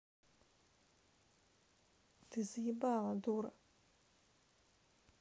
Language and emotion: Russian, angry